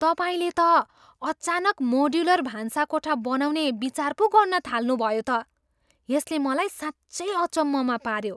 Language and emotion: Nepali, surprised